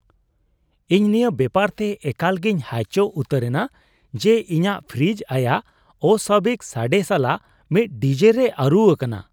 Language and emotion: Santali, surprised